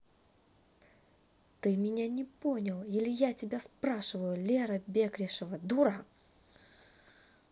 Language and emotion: Russian, angry